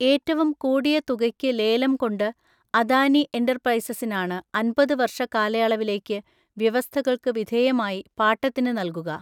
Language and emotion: Malayalam, neutral